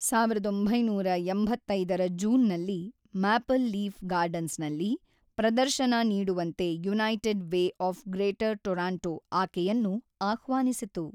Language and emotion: Kannada, neutral